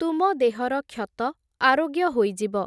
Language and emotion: Odia, neutral